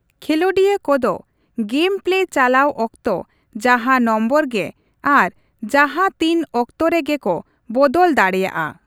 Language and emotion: Santali, neutral